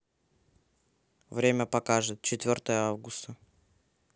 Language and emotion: Russian, neutral